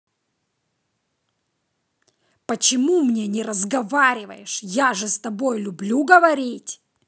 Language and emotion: Russian, angry